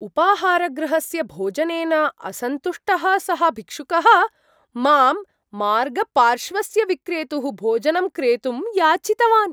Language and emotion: Sanskrit, surprised